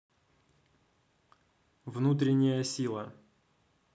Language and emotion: Russian, neutral